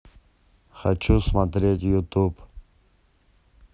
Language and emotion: Russian, neutral